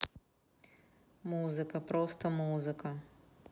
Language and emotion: Russian, neutral